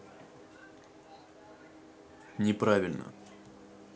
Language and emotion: Russian, neutral